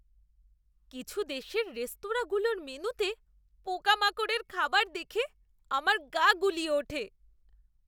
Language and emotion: Bengali, disgusted